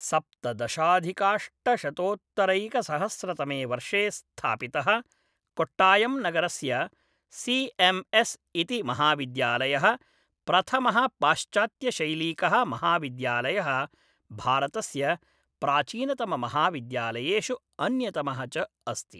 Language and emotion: Sanskrit, neutral